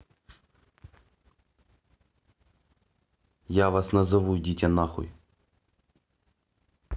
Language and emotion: Russian, angry